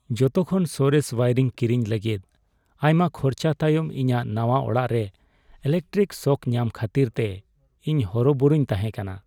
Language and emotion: Santali, sad